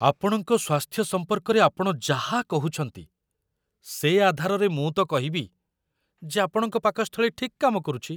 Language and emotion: Odia, surprised